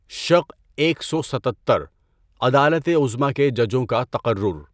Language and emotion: Urdu, neutral